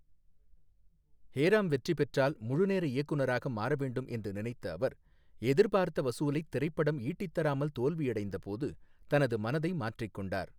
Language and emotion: Tamil, neutral